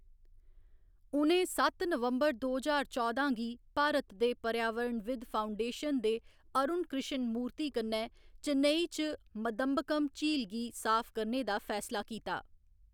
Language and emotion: Dogri, neutral